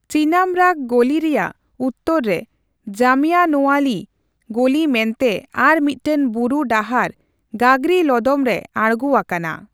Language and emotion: Santali, neutral